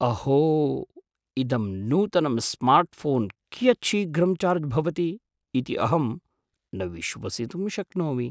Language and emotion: Sanskrit, surprised